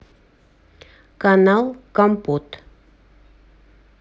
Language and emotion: Russian, neutral